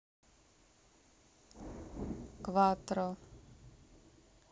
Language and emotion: Russian, neutral